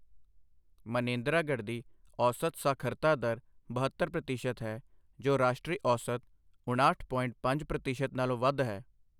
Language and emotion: Punjabi, neutral